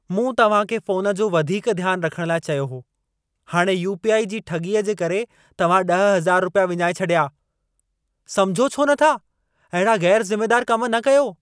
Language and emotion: Sindhi, angry